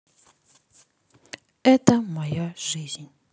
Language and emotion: Russian, neutral